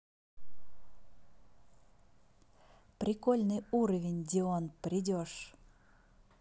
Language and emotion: Russian, positive